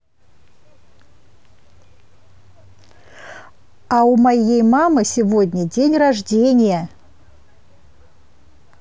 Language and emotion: Russian, positive